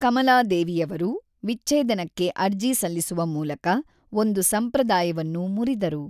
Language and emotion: Kannada, neutral